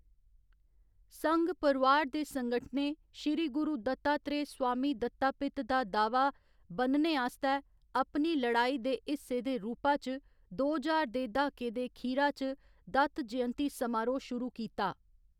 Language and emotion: Dogri, neutral